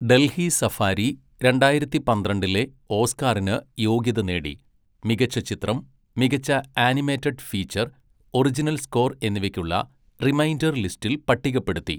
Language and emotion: Malayalam, neutral